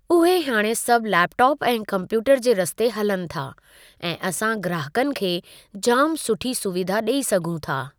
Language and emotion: Sindhi, neutral